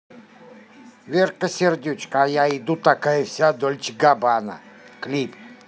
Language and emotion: Russian, neutral